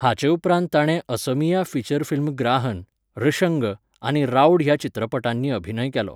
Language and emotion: Goan Konkani, neutral